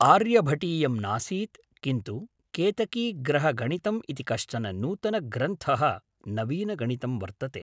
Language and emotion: Sanskrit, neutral